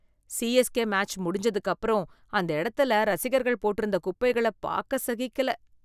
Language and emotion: Tamil, disgusted